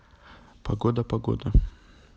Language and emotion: Russian, neutral